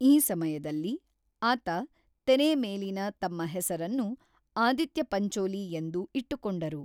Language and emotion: Kannada, neutral